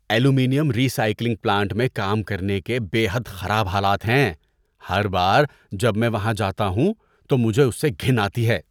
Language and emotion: Urdu, disgusted